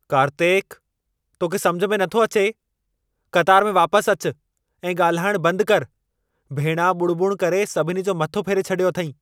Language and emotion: Sindhi, angry